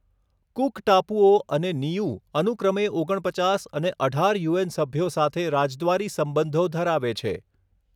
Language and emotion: Gujarati, neutral